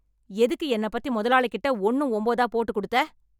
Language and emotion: Tamil, angry